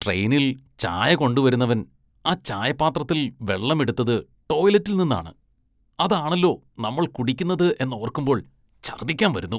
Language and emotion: Malayalam, disgusted